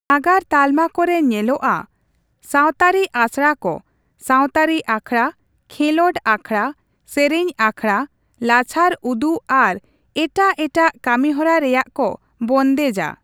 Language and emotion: Santali, neutral